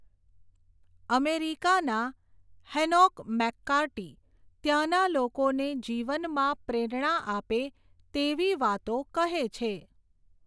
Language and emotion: Gujarati, neutral